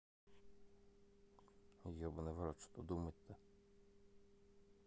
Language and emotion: Russian, neutral